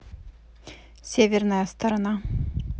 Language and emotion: Russian, neutral